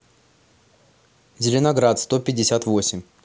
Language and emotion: Russian, neutral